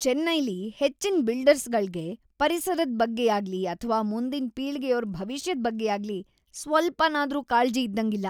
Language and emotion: Kannada, disgusted